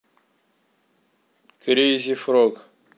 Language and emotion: Russian, neutral